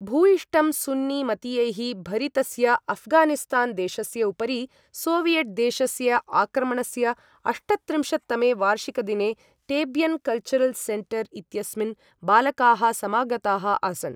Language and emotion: Sanskrit, neutral